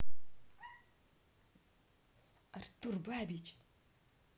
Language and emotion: Russian, neutral